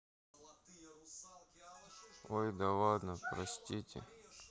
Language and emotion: Russian, sad